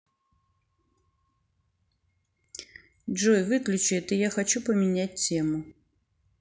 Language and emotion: Russian, neutral